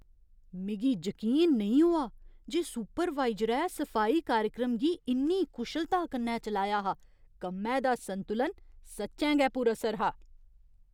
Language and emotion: Dogri, surprised